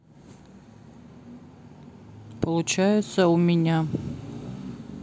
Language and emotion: Russian, sad